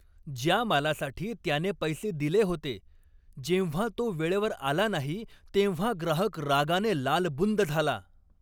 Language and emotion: Marathi, angry